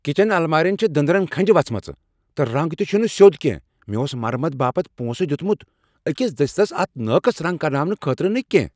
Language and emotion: Kashmiri, angry